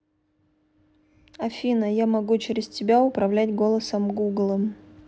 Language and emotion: Russian, neutral